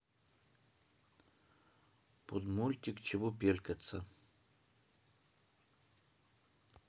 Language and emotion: Russian, neutral